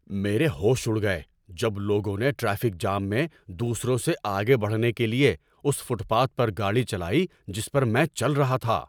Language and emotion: Urdu, angry